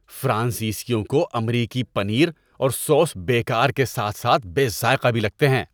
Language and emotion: Urdu, disgusted